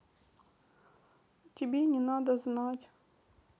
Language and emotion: Russian, sad